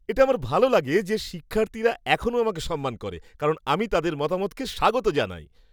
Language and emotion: Bengali, happy